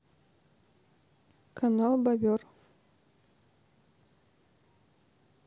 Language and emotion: Russian, neutral